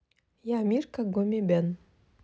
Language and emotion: Russian, neutral